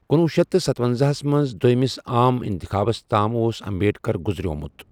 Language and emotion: Kashmiri, neutral